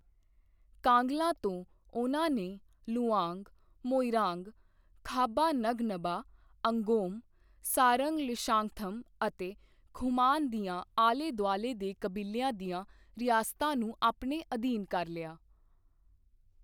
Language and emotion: Punjabi, neutral